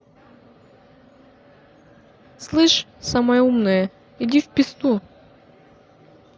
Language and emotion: Russian, angry